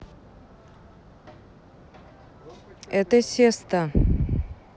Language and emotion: Russian, neutral